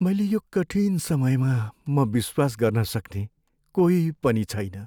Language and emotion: Nepali, sad